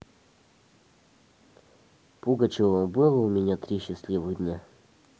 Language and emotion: Russian, neutral